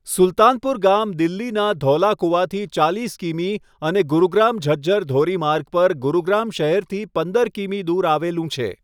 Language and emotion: Gujarati, neutral